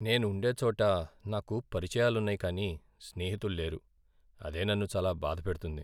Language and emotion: Telugu, sad